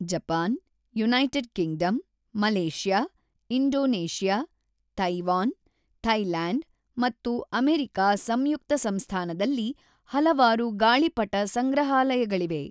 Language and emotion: Kannada, neutral